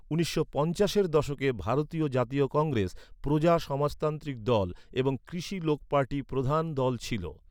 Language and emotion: Bengali, neutral